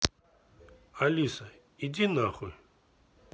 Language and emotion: Russian, neutral